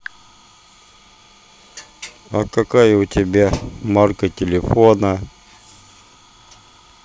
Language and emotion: Russian, neutral